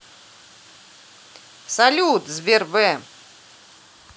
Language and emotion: Russian, positive